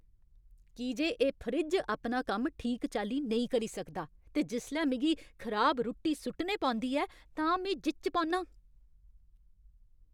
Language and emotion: Dogri, angry